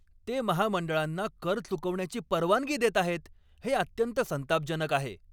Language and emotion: Marathi, angry